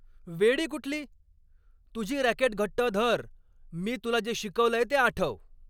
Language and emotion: Marathi, angry